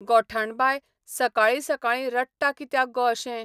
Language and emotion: Goan Konkani, neutral